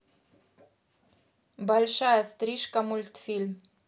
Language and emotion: Russian, neutral